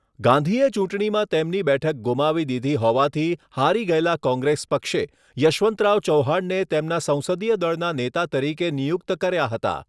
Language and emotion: Gujarati, neutral